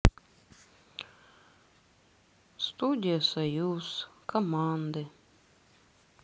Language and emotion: Russian, sad